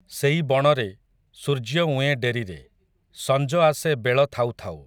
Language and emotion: Odia, neutral